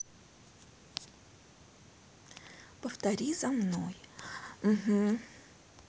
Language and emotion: Russian, neutral